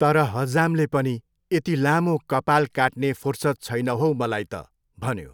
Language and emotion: Nepali, neutral